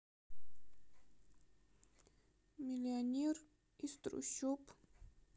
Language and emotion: Russian, sad